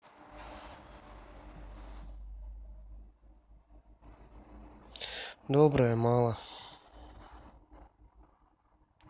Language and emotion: Russian, sad